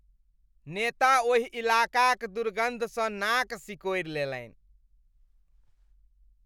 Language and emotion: Maithili, disgusted